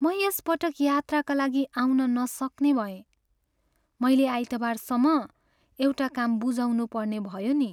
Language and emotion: Nepali, sad